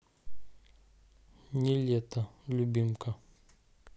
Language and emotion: Russian, neutral